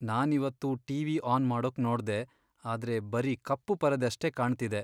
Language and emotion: Kannada, sad